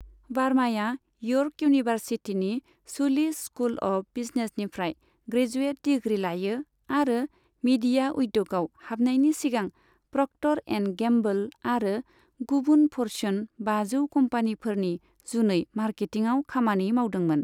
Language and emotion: Bodo, neutral